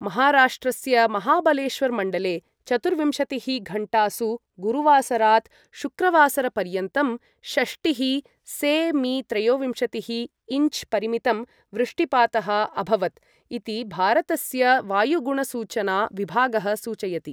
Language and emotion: Sanskrit, neutral